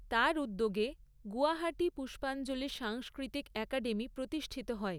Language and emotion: Bengali, neutral